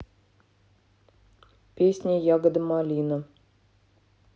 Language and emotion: Russian, neutral